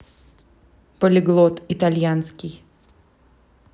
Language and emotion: Russian, neutral